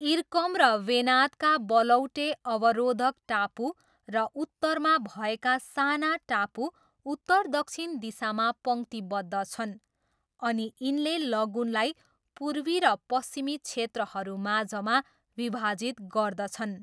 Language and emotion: Nepali, neutral